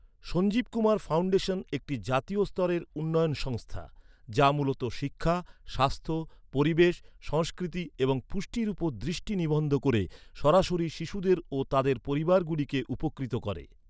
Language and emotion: Bengali, neutral